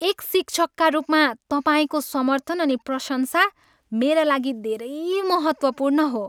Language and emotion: Nepali, happy